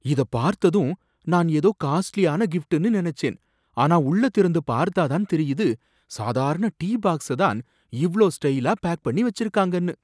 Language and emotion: Tamil, surprised